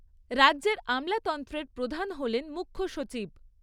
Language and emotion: Bengali, neutral